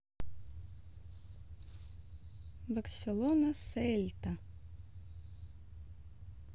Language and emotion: Russian, neutral